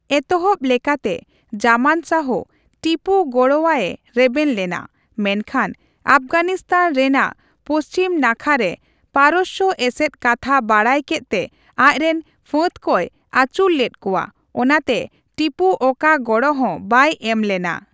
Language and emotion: Santali, neutral